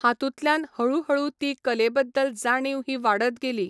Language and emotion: Goan Konkani, neutral